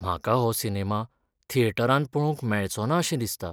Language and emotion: Goan Konkani, sad